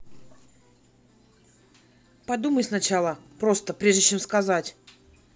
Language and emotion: Russian, angry